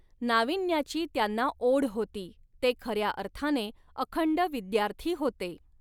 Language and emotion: Marathi, neutral